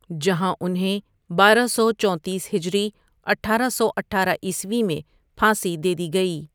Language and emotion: Urdu, neutral